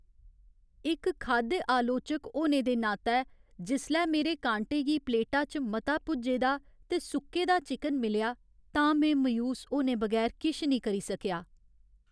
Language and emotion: Dogri, sad